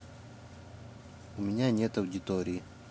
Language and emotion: Russian, neutral